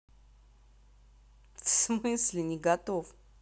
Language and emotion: Russian, neutral